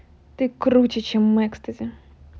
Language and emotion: Russian, positive